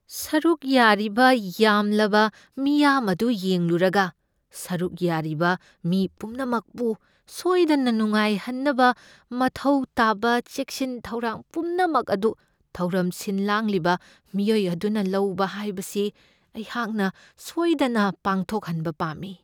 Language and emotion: Manipuri, fearful